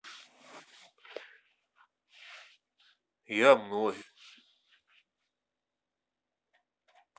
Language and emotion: Russian, neutral